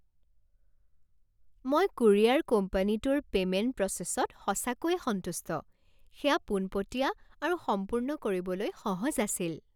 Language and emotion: Assamese, happy